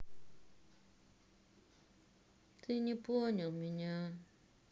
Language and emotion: Russian, sad